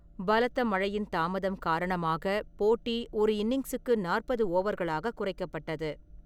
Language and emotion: Tamil, neutral